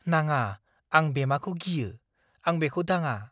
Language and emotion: Bodo, fearful